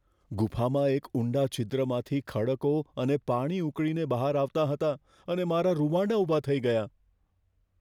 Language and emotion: Gujarati, fearful